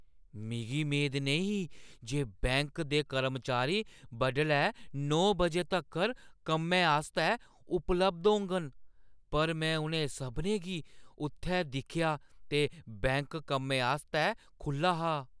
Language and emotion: Dogri, surprised